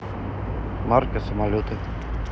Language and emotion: Russian, neutral